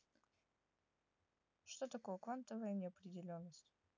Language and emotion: Russian, neutral